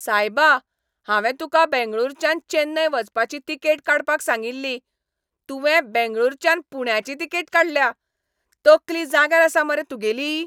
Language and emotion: Goan Konkani, angry